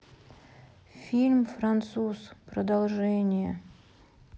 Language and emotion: Russian, sad